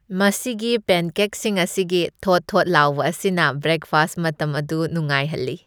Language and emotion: Manipuri, happy